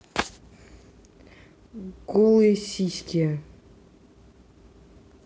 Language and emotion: Russian, neutral